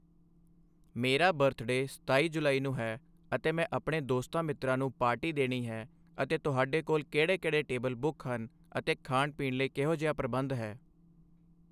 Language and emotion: Punjabi, neutral